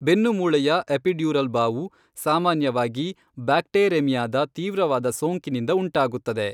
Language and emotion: Kannada, neutral